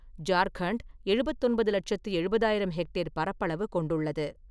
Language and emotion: Tamil, neutral